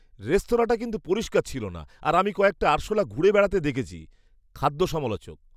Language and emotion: Bengali, disgusted